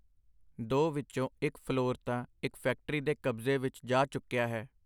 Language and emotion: Punjabi, neutral